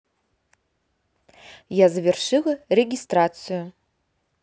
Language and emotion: Russian, neutral